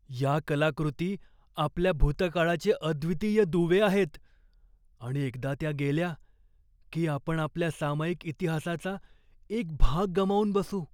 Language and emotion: Marathi, fearful